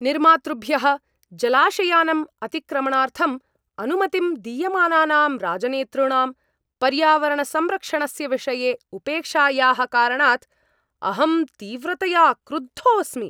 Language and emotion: Sanskrit, angry